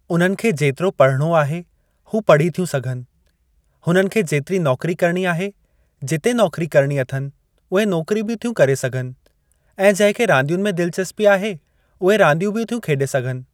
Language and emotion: Sindhi, neutral